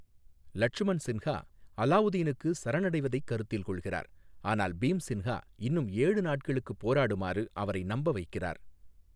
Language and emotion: Tamil, neutral